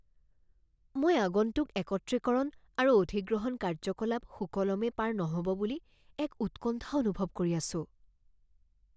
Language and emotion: Assamese, fearful